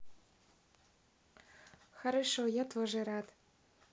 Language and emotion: Russian, positive